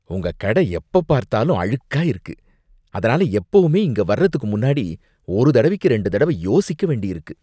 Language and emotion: Tamil, disgusted